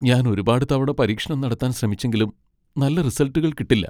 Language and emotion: Malayalam, sad